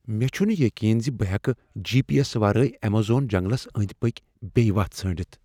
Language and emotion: Kashmiri, fearful